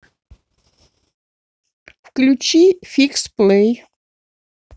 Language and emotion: Russian, neutral